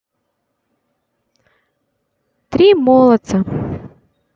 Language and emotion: Russian, positive